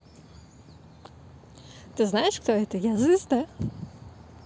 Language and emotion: Russian, positive